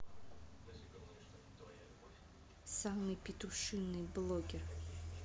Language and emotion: Russian, neutral